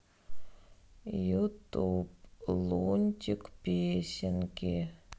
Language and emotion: Russian, sad